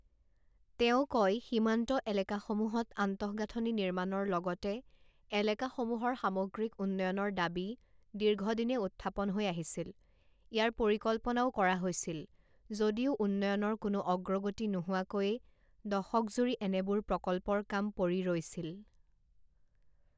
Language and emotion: Assamese, neutral